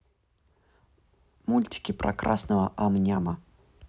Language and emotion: Russian, neutral